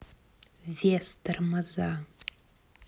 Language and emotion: Russian, neutral